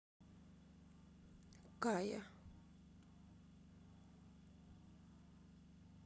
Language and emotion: Russian, sad